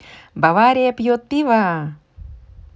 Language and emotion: Russian, positive